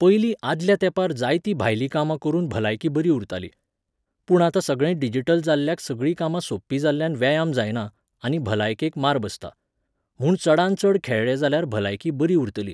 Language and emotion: Goan Konkani, neutral